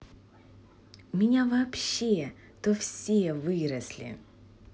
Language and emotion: Russian, positive